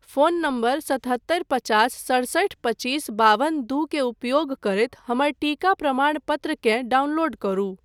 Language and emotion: Maithili, neutral